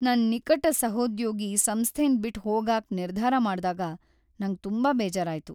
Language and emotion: Kannada, sad